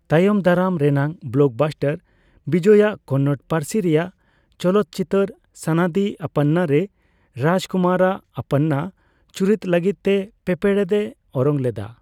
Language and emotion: Santali, neutral